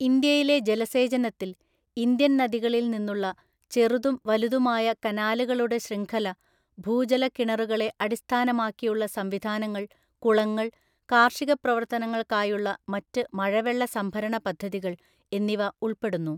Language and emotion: Malayalam, neutral